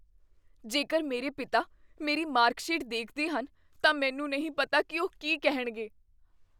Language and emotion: Punjabi, fearful